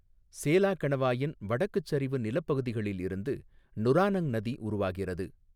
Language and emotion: Tamil, neutral